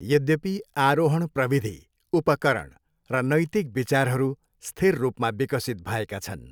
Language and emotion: Nepali, neutral